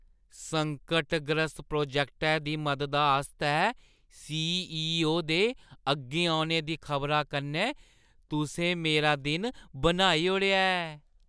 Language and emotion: Dogri, happy